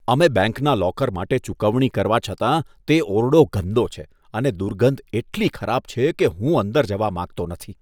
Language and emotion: Gujarati, disgusted